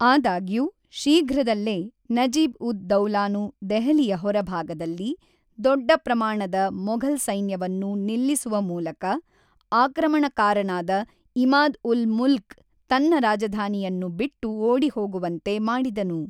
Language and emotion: Kannada, neutral